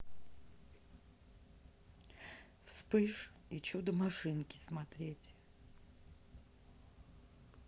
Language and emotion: Russian, neutral